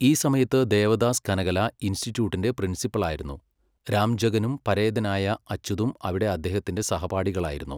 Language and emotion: Malayalam, neutral